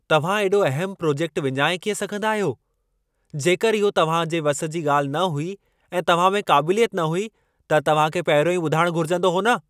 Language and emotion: Sindhi, angry